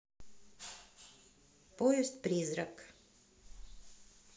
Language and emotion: Russian, neutral